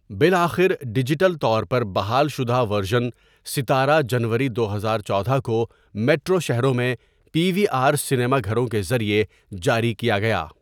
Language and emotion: Urdu, neutral